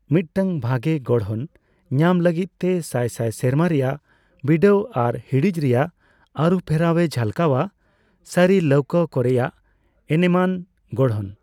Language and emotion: Santali, neutral